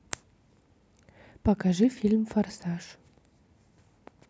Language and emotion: Russian, neutral